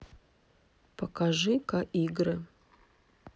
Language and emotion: Russian, neutral